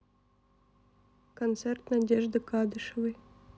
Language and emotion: Russian, neutral